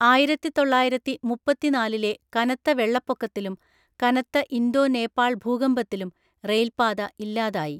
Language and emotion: Malayalam, neutral